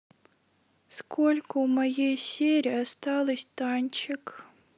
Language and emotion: Russian, sad